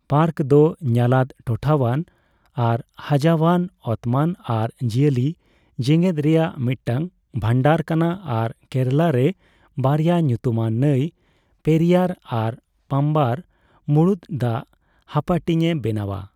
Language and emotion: Santali, neutral